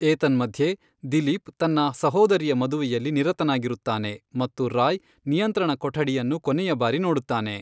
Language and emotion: Kannada, neutral